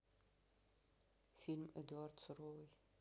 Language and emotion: Russian, neutral